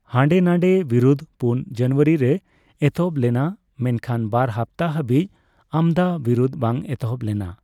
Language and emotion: Santali, neutral